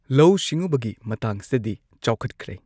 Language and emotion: Manipuri, neutral